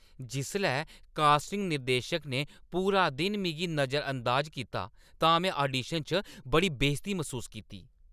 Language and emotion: Dogri, angry